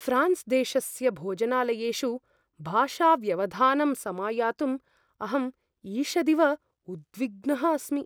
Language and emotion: Sanskrit, fearful